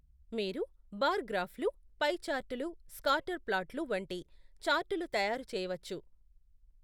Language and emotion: Telugu, neutral